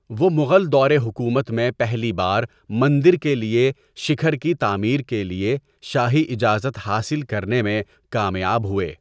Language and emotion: Urdu, neutral